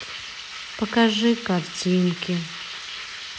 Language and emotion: Russian, sad